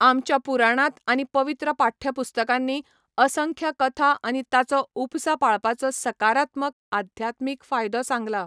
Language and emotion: Goan Konkani, neutral